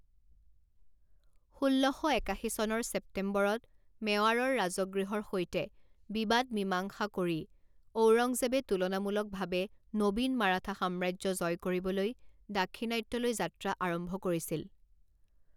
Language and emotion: Assamese, neutral